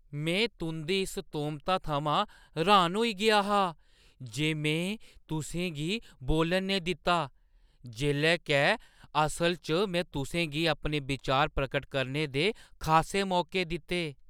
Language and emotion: Dogri, surprised